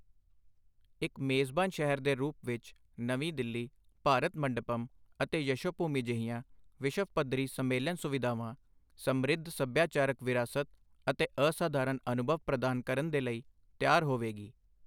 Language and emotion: Punjabi, neutral